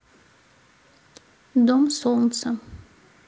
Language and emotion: Russian, neutral